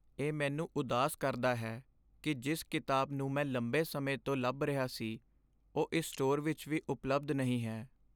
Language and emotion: Punjabi, sad